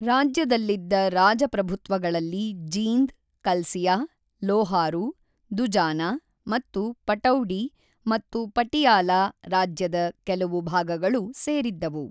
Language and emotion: Kannada, neutral